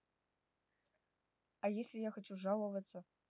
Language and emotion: Russian, neutral